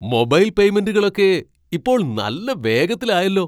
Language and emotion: Malayalam, surprised